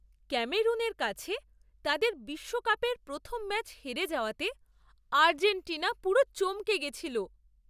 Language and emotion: Bengali, surprised